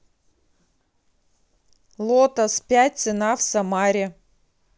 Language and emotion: Russian, neutral